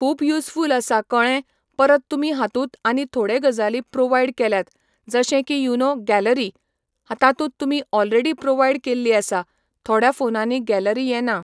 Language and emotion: Goan Konkani, neutral